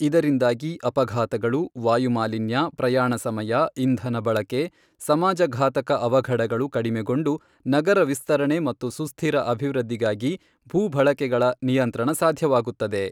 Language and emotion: Kannada, neutral